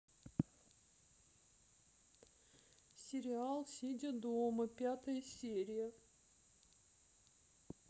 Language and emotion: Russian, sad